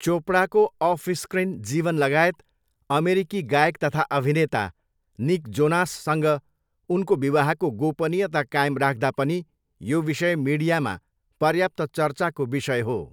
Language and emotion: Nepali, neutral